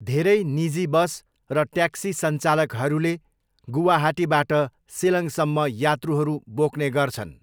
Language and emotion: Nepali, neutral